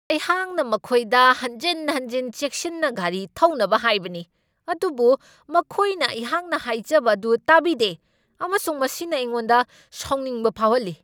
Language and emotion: Manipuri, angry